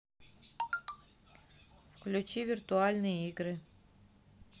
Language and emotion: Russian, neutral